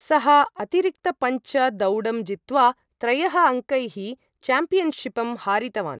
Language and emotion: Sanskrit, neutral